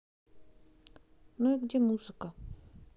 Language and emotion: Russian, neutral